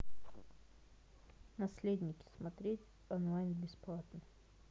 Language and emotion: Russian, neutral